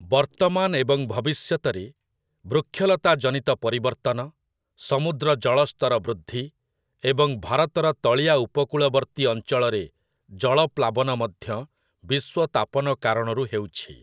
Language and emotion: Odia, neutral